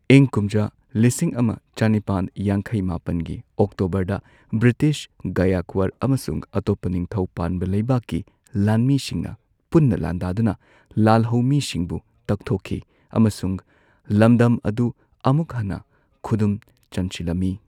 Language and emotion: Manipuri, neutral